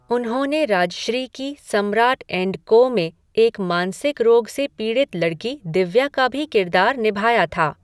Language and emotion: Hindi, neutral